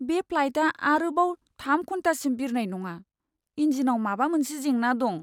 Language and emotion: Bodo, sad